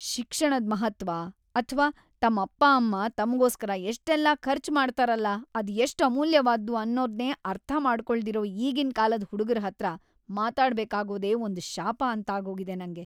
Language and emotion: Kannada, disgusted